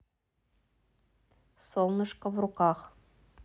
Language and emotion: Russian, neutral